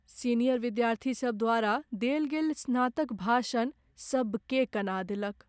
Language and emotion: Maithili, sad